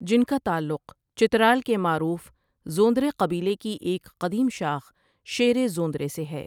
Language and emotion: Urdu, neutral